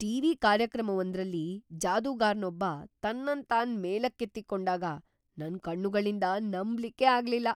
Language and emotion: Kannada, surprised